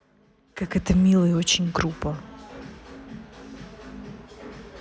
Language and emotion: Russian, neutral